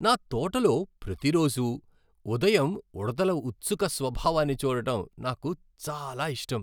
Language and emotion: Telugu, happy